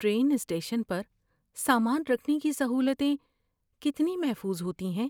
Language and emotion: Urdu, fearful